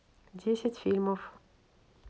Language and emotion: Russian, neutral